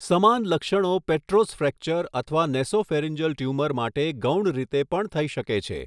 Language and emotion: Gujarati, neutral